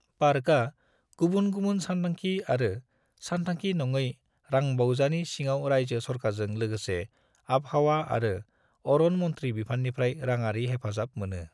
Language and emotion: Bodo, neutral